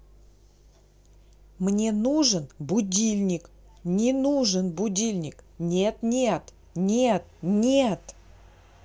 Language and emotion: Russian, neutral